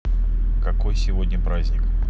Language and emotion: Russian, neutral